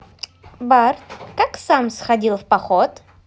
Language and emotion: Russian, positive